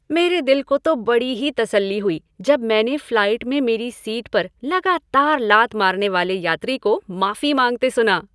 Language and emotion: Hindi, happy